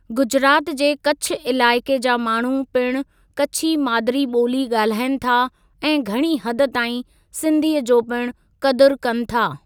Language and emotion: Sindhi, neutral